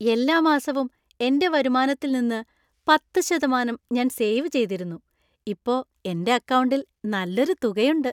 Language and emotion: Malayalam, happy